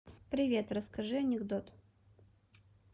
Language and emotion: Russian, neutral